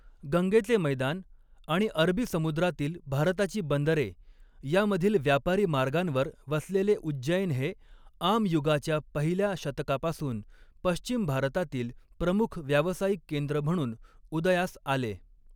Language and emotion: Marathi, neutral